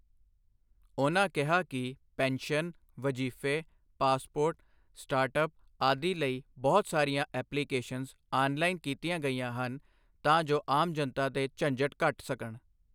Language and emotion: Punjabi, neutral